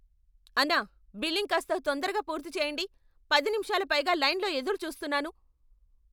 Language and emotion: Telugu, angry